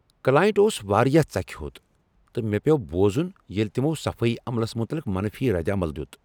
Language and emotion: Kashmiri, angry